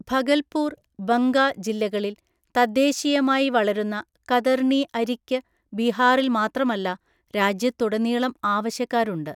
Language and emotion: Malayalam, neutral